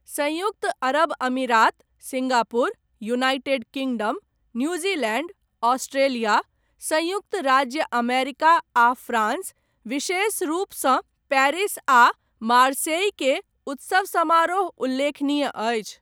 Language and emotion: Maithili, neutral